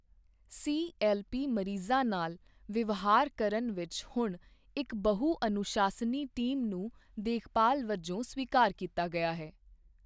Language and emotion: Punjabi, neutral